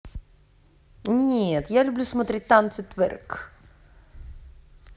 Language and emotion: Russian, neutral